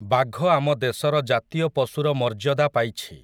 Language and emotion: Odia, neutral